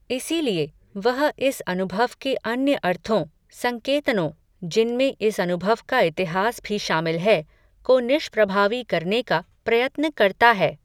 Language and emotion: Hindi, neutral